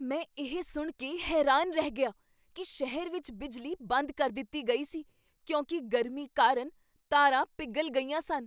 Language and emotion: Punjabi, surprised